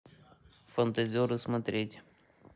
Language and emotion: Russian, neutral